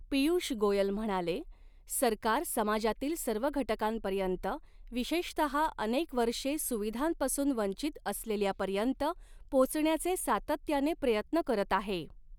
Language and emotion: Marathi, neutral